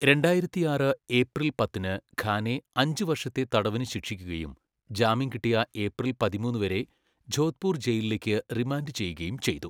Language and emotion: Malayalam, neutral